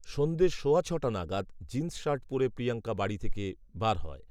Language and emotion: Bengali, neutral